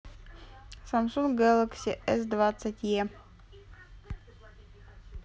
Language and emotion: Russian, neutral